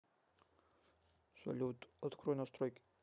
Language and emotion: Russian, neutral